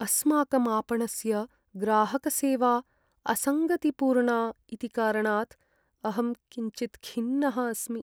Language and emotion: Sanskrit, sad